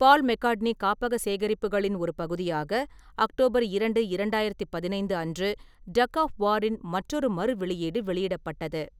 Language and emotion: Tamil, neutral